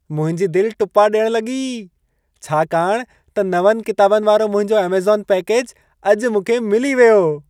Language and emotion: Sindhi, happy